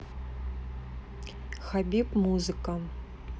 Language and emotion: Russian, neutral